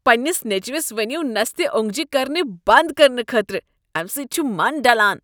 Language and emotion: Kashmiri, disgusted